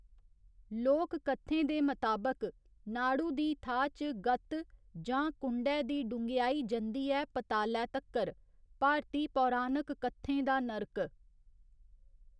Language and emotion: Dogri, neutral